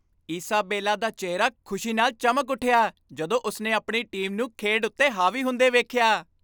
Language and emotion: Punjabi, happy